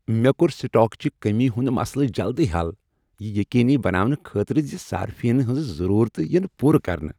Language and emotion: Kashmiri, happy